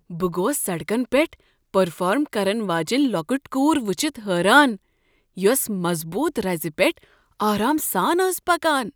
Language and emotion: Kashmiri, surprised